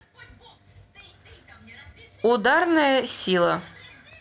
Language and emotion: Russian, neutral